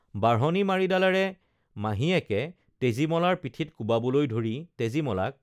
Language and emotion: Assamese, neutral